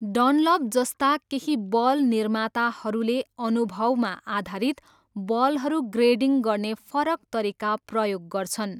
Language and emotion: Nepali, neutral